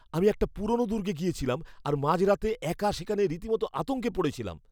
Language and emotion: Bengali, fearful